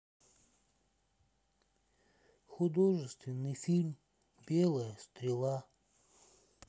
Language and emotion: Russian, sad